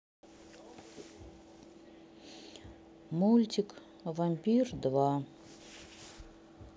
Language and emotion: Russian, sad